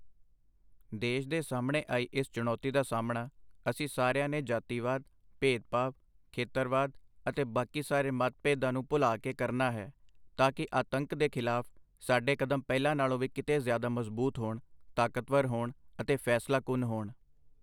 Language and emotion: Punjabi, neutral